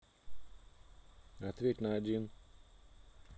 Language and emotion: Russian, neutral